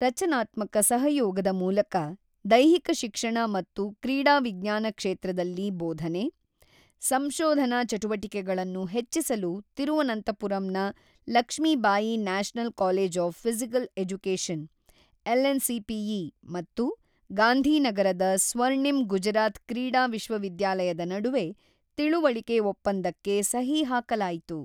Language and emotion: Kannada, neutral